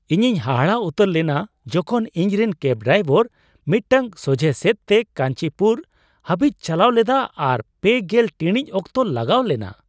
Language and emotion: Santali, surprised